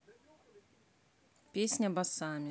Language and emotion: Russian, neutral